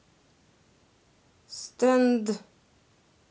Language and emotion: Russian, neutral